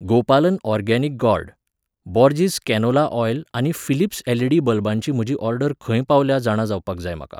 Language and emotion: Goan Konkani, neutral